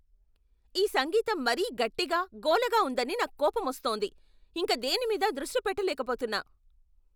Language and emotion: Telugu, angry